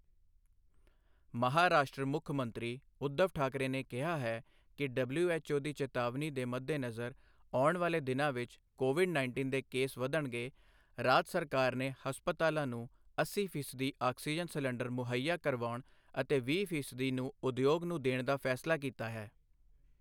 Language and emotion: Punjabi, neutral